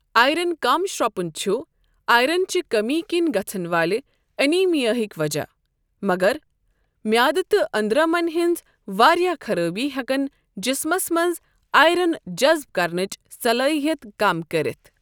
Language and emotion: Kashmiri, neutral